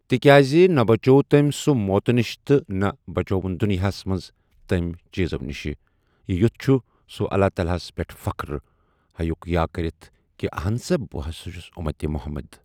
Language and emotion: Kashmiri, neutral